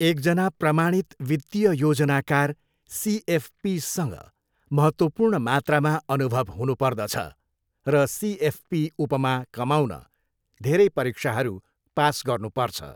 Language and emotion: Nepali, neutral